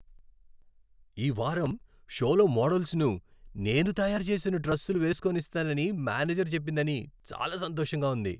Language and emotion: Telugu, happy